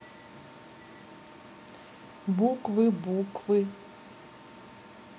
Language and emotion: Russian, neutral